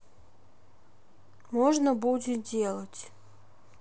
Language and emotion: Russian, sad